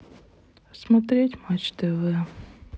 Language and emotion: Russian, sad